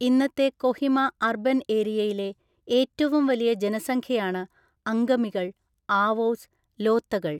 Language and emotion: Malayalam, neutral